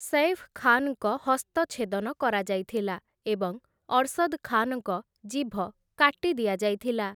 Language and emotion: Odia, neutral